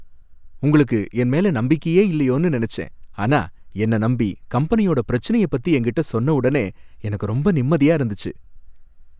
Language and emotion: Tamil, happy